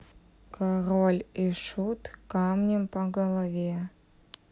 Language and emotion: Russian, neutral